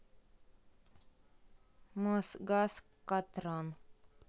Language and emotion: Russian, neutral